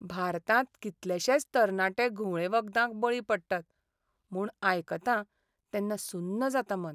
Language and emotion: Goan Konkani, sad